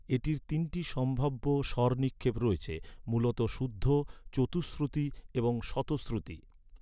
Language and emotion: Bengali, neutral